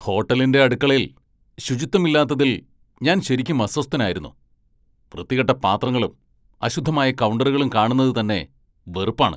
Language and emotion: Malayalam, angry